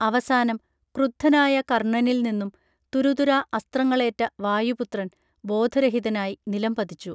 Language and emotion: Malayalam, neutral